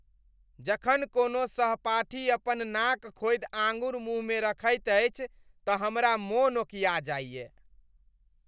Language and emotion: Maithili, disgusted